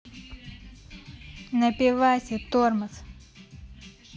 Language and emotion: Russian, angry